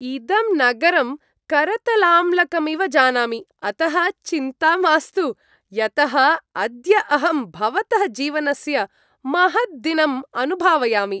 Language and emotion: Sanskrit, happy